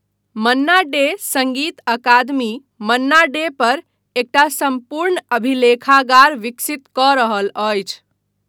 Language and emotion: Maithili, neutral